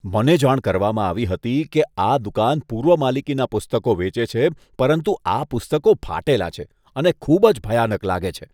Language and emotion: Gujarati, disgusted